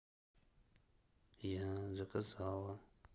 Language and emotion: Russian, neutral